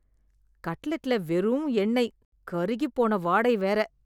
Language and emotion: Tamil, disgusted